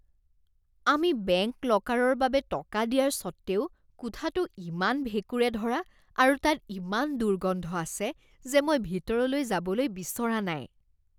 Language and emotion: Assamese, disgusted